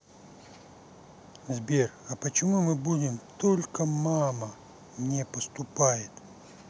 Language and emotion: Russian, sad